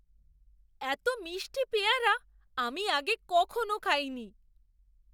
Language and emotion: Bengali, surprised